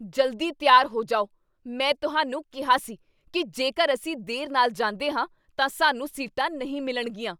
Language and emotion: Punjabi, angry